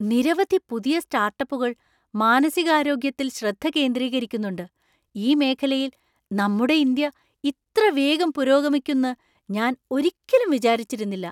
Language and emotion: Malayalam, surprised